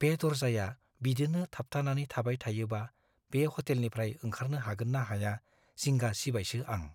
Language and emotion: Bodo, fearful